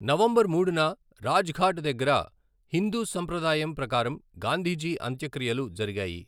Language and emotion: Telugu, neutral